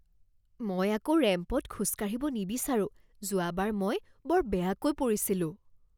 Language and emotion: Assamese, fearful